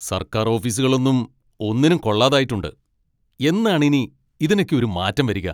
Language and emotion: Malayalam, angry